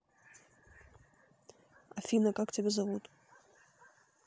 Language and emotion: Russian, neutral